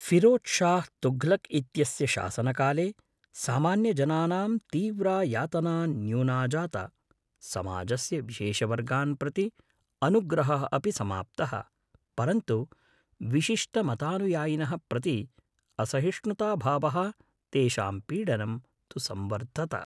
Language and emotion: Sanskrit, neutral